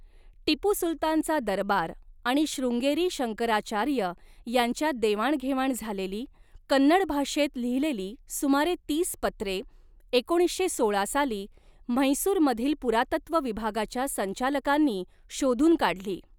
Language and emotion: Marathi, neutral